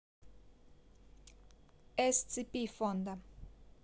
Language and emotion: Russian, neutral